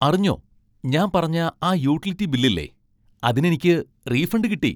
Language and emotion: Malayalam, happy